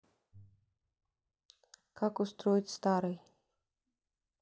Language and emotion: Russian, neutral